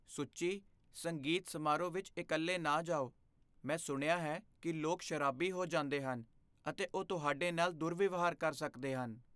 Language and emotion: Punjabi, fearful